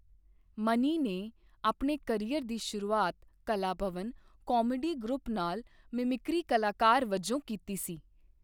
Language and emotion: Punjabi, neutral